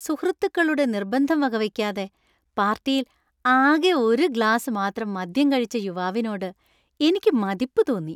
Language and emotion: Malayalam, happy